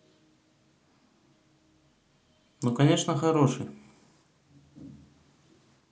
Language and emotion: Russian, neutral